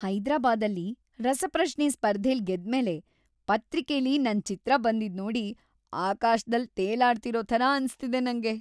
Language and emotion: Kannada, happy